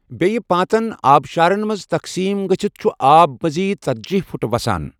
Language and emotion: Kashmiri, neutral